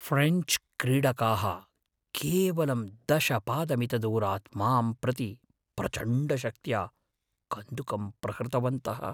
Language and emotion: Sanskrit, fearful